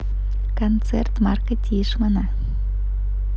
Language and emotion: Russian, positive